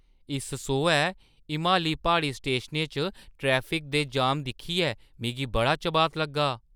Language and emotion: Dogri, surprised